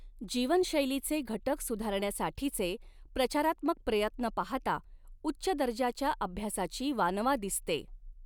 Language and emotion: Marathi, neutral